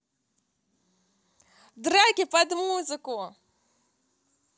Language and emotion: Russian, positive